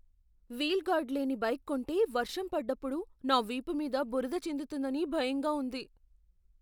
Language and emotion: Telugu, fearful